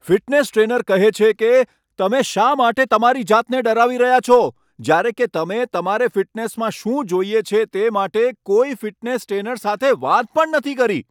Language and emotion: Gujarati, angry